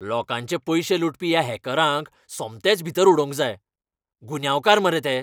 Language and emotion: Goan Konkani, angry